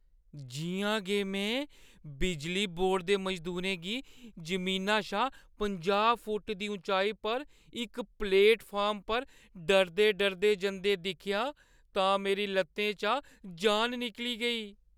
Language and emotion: Dogri, fearful